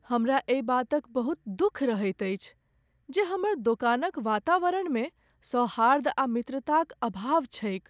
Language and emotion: Maithili, sad